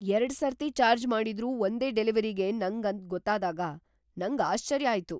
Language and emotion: Kannada, surprised